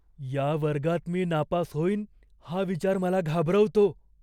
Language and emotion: Marathi, fearful